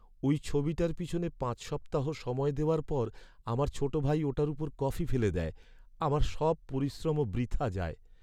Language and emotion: Bengali, sad